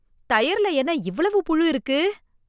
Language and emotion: Tamil, disgusted